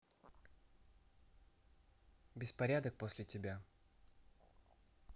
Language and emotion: Russian, neutral